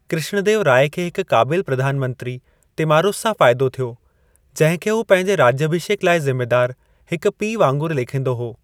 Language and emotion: Sindhi, neutral